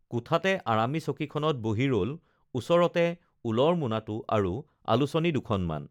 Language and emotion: Assamese, neutral